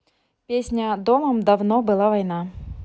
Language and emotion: Russian, neutral